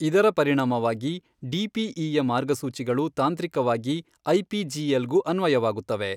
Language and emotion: Kannada, neutral